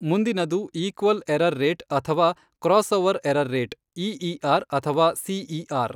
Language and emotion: Kannada, neutral